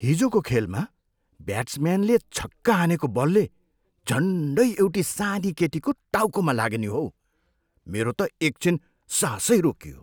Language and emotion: Nepali, surprised